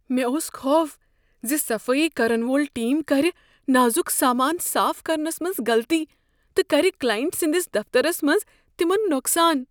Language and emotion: Kashmiri, fearful